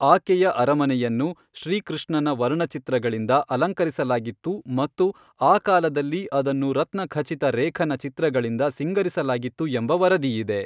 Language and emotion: Kannada, neutral